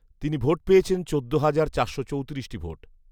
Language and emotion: Bengali, neutral